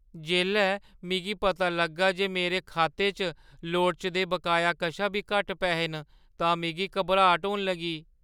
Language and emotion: Dogri, fearful